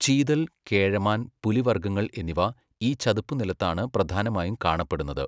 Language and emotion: Malayalam, neutral